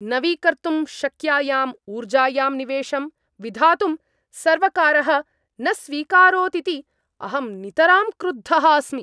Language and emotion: Sanskrit, angry